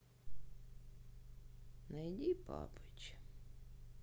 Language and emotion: Russian, sad